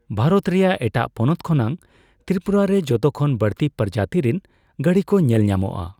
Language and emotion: Santali, neutral